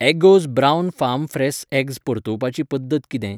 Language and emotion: Goan Konkani, neutral